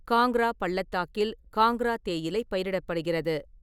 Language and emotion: Tamil, neutral